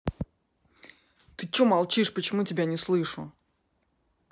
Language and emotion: Russian, angry